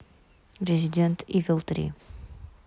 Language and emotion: Russian, neutral